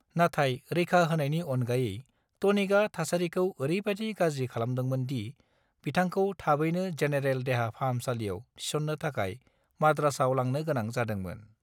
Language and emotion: Bodo, neutral